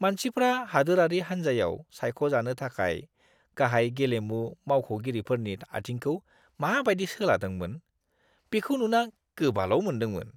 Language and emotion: Bodo, disgusted